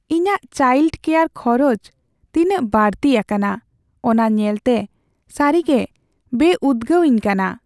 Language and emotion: Santali, sad